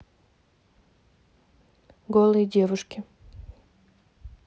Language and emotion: Russian, neutral